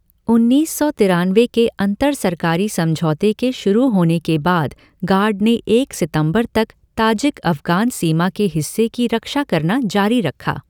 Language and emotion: Hindi, neutral